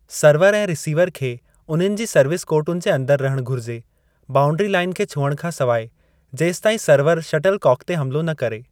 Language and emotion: Sindhi, neutral